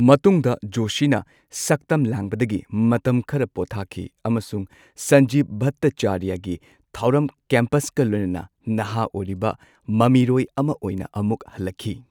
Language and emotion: Manipuri, neutral